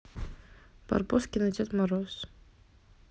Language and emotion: Russian, neutral